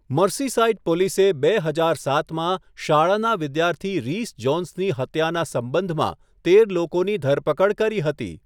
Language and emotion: Gujarati, neutral